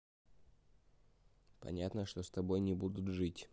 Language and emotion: Russian, neutral